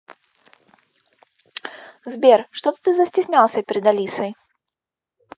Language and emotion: Russian, positive